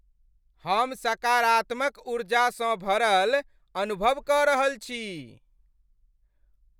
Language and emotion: Maithili, happy